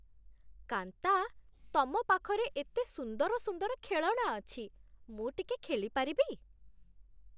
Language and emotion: Odia, happy